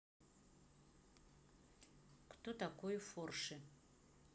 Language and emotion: Russian, neutral